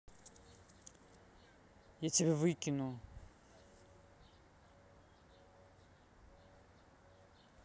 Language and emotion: Russian, angry